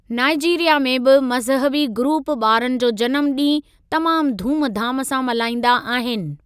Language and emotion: Sindhi, neutral